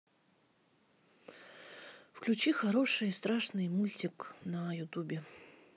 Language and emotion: Russian, sad